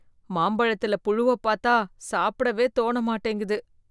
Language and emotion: Tamil, disgusted